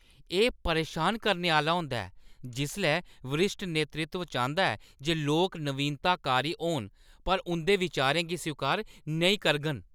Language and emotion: Dogri, angry